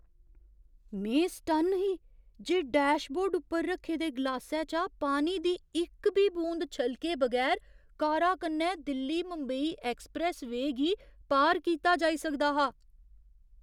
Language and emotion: Dogri, surprised